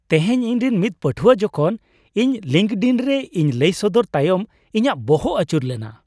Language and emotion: Santali, happy